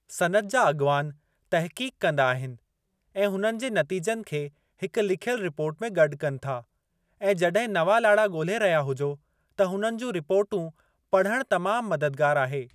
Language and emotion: Sindhi, neutral